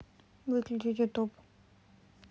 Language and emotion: Russian, neutral